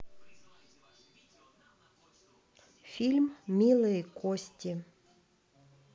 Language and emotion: Russian, neutral